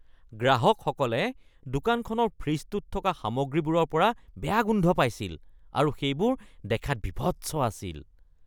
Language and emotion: Assamese, disgusted